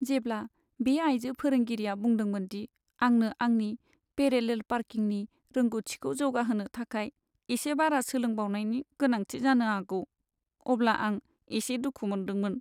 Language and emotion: Bodo, sad